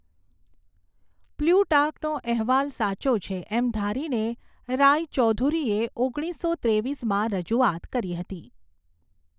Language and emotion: Gujarati, neutral